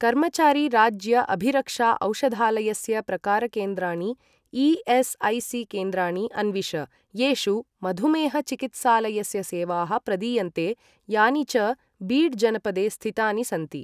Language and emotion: Sanskrit, neutral